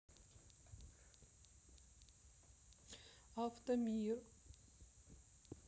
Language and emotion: Russian, neutral